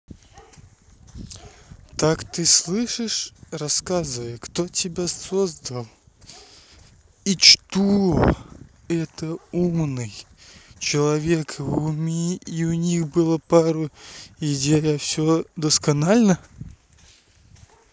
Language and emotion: Russian, angry